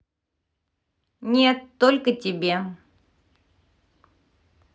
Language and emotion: Russian, neutral